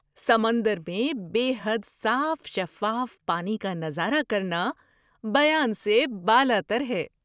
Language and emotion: Urdu, surprised